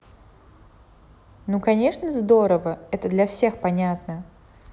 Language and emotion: Russian, neutral